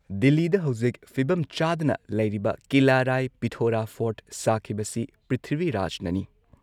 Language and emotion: Manipuri, neutral